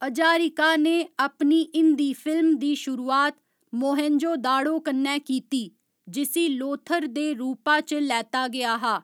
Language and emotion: Dogri, neutral